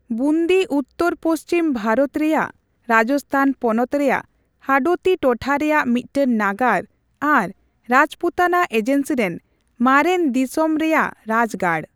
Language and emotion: Santali, neutral